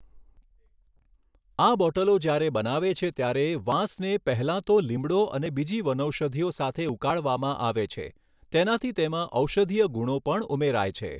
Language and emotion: Gujarati, neutral